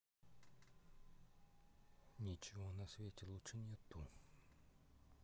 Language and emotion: Russian, neutral